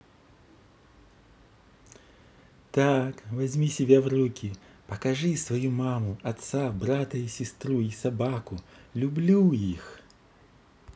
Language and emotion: Russian, positive